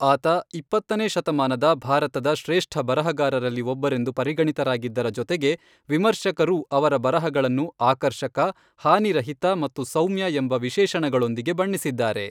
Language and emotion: Kannada, neutral